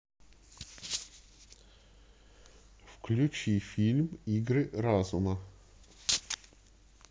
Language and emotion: Russian, neutral